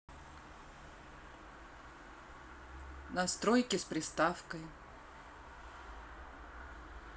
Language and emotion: Russian, neutral